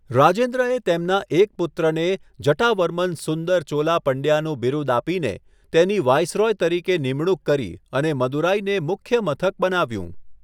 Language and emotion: Gujarati, neutral